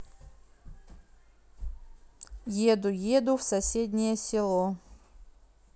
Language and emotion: Russian, neutral